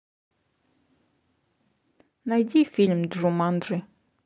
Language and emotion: Russian, neutral